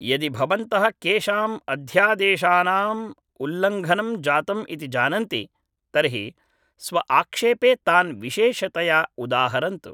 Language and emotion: Sanskrit, neutral